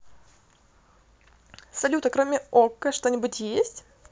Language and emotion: Russian, positive